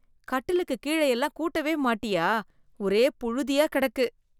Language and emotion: Tamil, disgusted